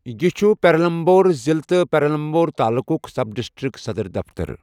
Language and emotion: Kashmiri, neutral